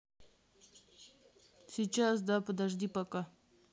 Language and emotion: Russian, neutral